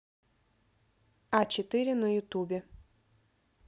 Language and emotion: Russian, neutral